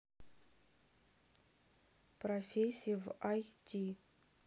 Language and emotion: Russian, neutral